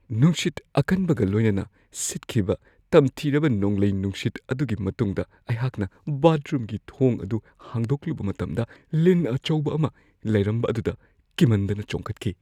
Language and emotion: Manipuri, fearful